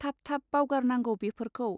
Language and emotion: Bodo, neutral